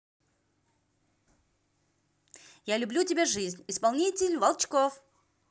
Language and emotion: Russian, positive